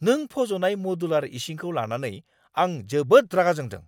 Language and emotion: Bodo, angry